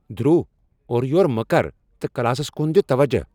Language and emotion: Kashmiri, angry